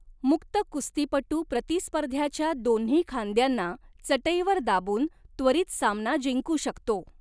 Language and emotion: Marathi, neutral